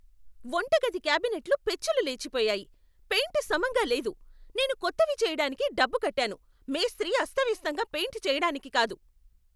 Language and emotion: Telugu, angry